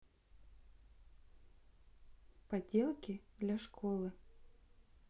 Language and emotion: Russian, neutral